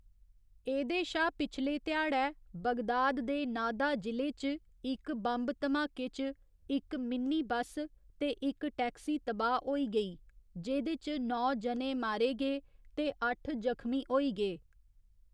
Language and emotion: Dogri, neutral